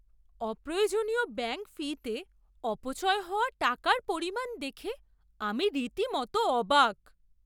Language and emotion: Bengali, surprised